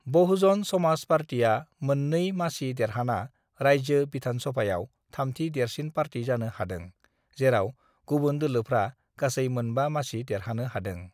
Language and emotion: Bodo, neutral